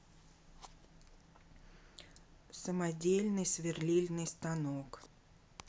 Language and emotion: Russian, neutral